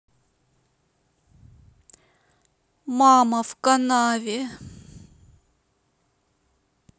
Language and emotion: Russian, sad